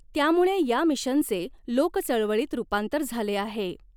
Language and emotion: Marathi, neutral